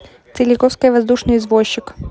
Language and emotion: Russian, neutral